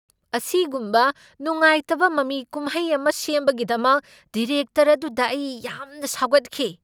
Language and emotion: Manipuri, angry